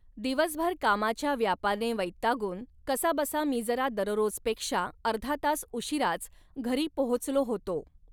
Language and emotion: Marathi, neutral